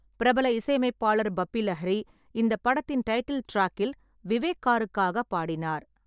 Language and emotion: Tamil, neutral